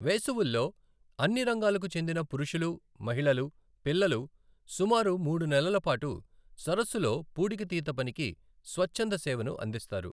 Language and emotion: Telugu, neutral